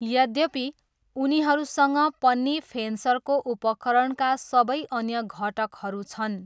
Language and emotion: Nepali, neutral